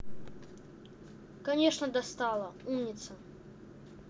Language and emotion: Russian, angry